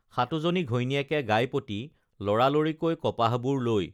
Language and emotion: Assamese, neutral